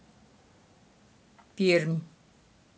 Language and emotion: Russian, neutral